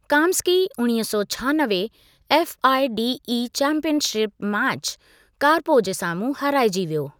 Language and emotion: Sindhi, neutral